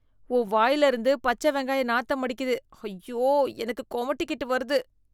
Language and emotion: Tamil, disgusted